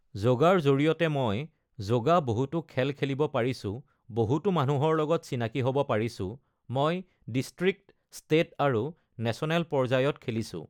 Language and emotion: Assamese, neutral